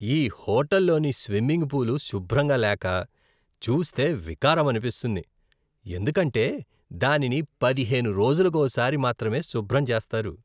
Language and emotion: Telugu, disgusted